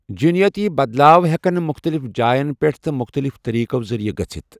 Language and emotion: Kashmiri, neutral